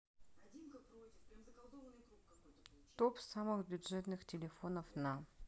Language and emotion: Russian, neutral